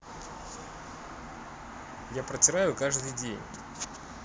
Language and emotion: Russian, neutral